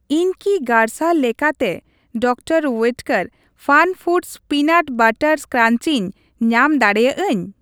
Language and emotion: Santali, neutral